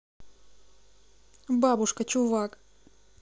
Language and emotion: Russian, neutral